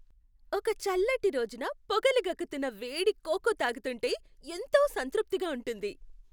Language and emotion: Telugu, happy